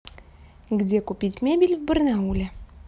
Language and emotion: Russian, neutral